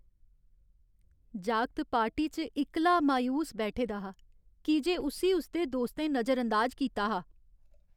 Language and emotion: Dogri, sad